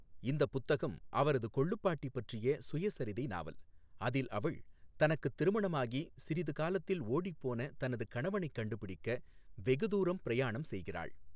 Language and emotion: Tamil, neutral